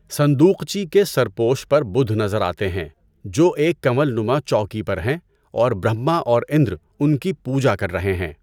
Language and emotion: Urdu, neutral